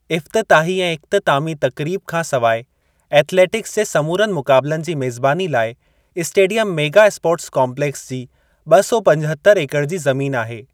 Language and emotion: Sindhi, neutral